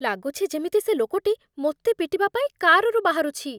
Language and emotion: Odia, fearful